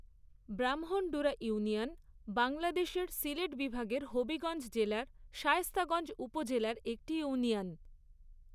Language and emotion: Bengali, neutral